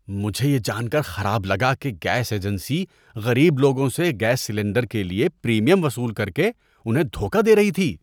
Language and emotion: Urdu, disgusted